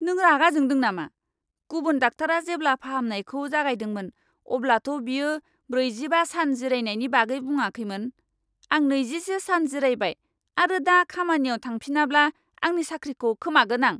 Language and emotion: Bodo, angry